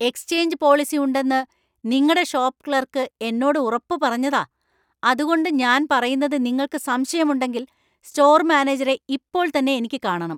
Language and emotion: Malayalam, angry